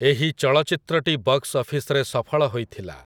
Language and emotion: Odia, neutral